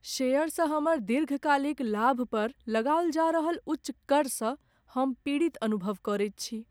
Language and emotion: Maithili, sad